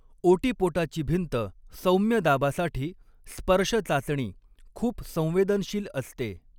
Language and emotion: Marathi, neutral